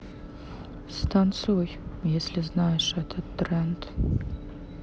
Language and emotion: Russian, sad